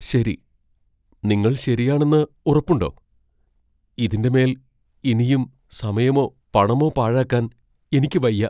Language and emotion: Malayalam, fearful